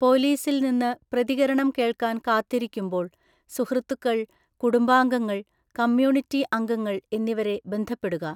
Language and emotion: Malayalam, neutral